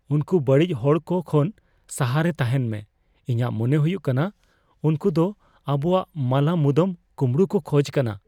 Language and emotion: Santali, fearful